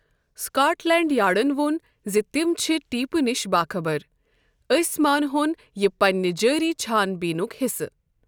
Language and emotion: Kashmiri, neutral